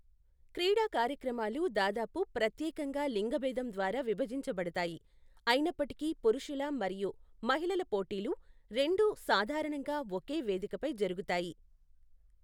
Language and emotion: Telugu, neutral